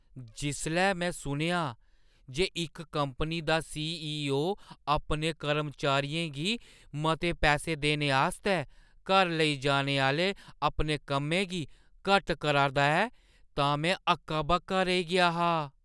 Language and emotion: Dogri, surprised